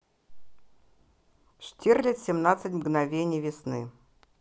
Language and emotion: Russian, neutral